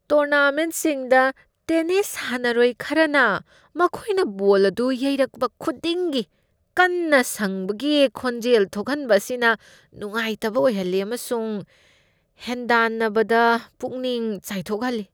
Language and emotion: Manipuri, disgusted